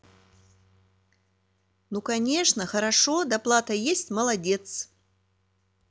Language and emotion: Russian, positive